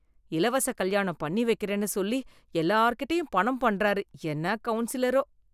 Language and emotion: Tamil, disgusted